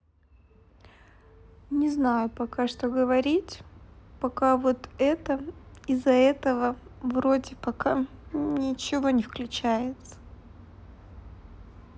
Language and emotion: Russian, sad